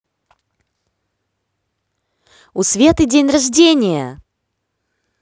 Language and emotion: Russian, positive